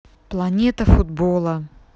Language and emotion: Russian, neutral